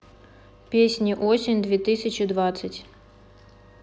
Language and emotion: Russian, neutral